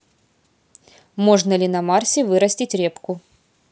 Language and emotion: Russian, neutral